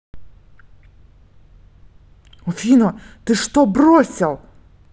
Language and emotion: Russian, angry